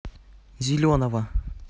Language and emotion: Russian, neutral